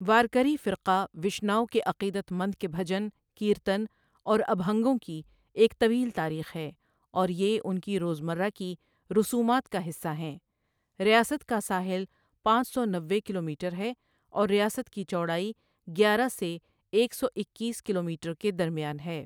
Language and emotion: Urdu, neutral